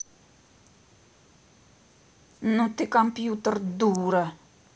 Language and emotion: Russian, angry